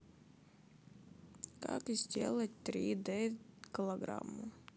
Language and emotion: Russian, sad